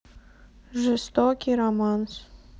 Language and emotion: Russian, neutral